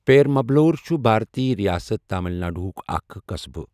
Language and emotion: Kashmiri, neutral